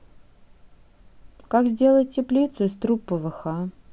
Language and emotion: Russian, neutral